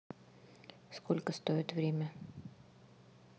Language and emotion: Russian, neutral